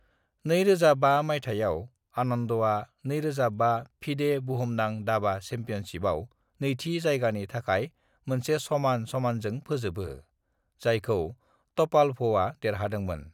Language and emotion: Bodo, neutral